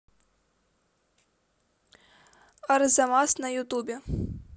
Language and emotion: Russian, neutral